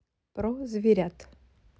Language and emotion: Russian, neutral